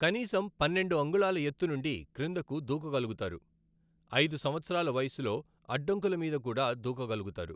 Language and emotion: Telugu, neutral